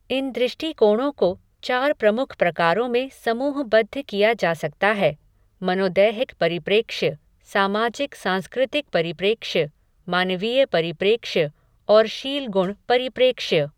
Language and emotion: Hindi, neutral